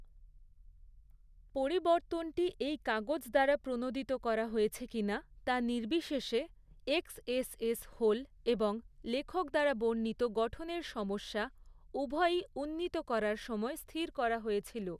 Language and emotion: Bengali, neutral